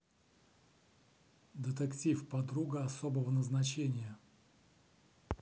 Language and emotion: Russian, neutral